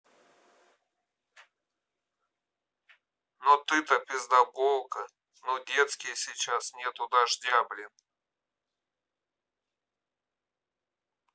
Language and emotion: Russian, angry